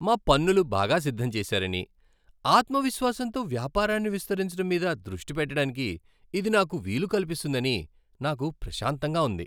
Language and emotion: Telugu, happy